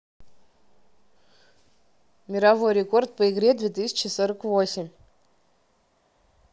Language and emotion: Russian, neutral